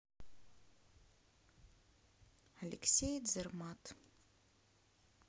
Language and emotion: Russian, neutral